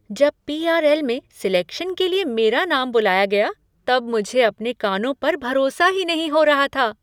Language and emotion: Hindi, surprised